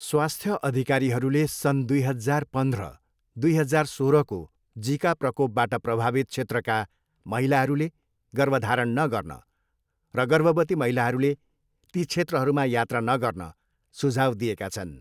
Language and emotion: Nepali, neutral